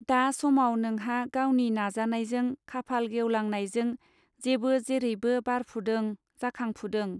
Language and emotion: Bodo, neutral